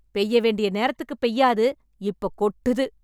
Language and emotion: Tamil, angry